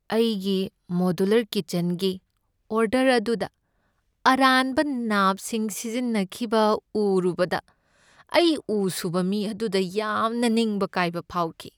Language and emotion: Manipuri, sad